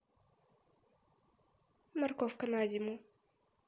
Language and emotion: Russian, neutral